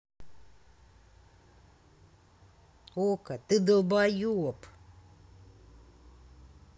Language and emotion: Russian, angry